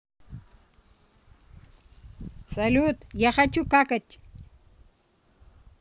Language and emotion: Russian, neutral